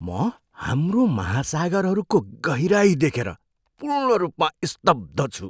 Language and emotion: Nepali, surprised